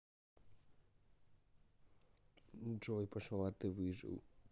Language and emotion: Russian, neutral